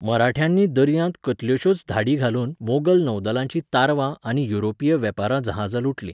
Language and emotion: Goan Konkani, neutral